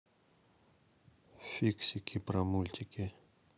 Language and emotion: Russian, neutral